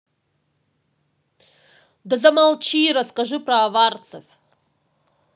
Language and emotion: Russian, angry